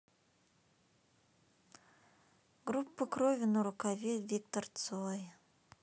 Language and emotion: Russian, sad